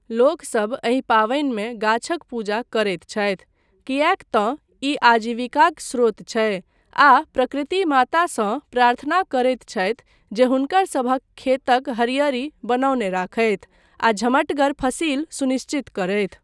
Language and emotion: Maithili, neutral